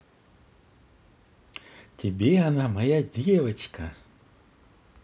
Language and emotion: Russian, positive